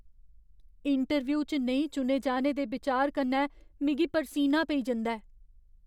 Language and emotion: Dogri, fearful